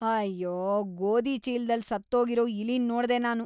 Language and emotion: Kannada, disgusted